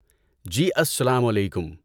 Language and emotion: Urdu, neutral